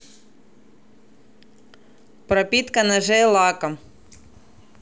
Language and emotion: Russian, neutral